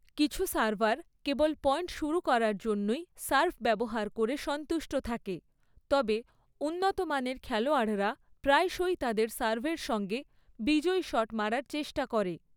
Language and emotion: Bengali, neutral